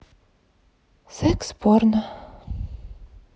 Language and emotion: Russian, sad